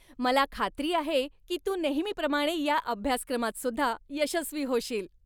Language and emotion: Marathi, happy